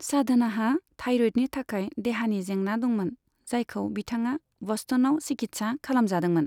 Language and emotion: Bodo, neutral